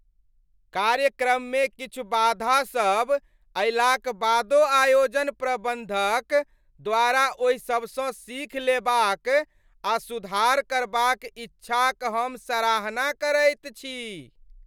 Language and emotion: Maithili, happy